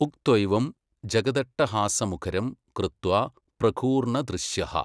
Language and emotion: Malayalam, neutral